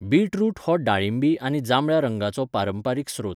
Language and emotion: Goan Konkani, neutral